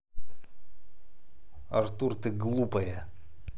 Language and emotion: Russian, angry